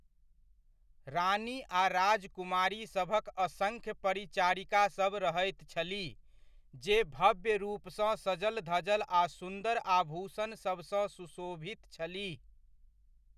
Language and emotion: Maithili, neutral